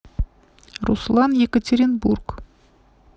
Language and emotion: Russian, neutral